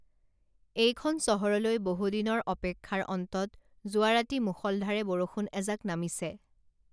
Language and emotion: Assamese, neutral